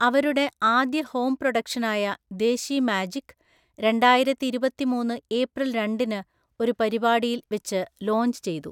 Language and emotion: Malayalam, neutral